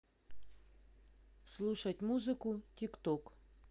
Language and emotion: Russian, neutral